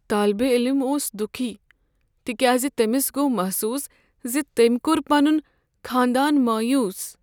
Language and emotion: Kashmiri, sad